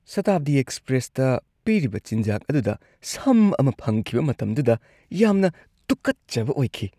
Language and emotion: Manipuri, disgusted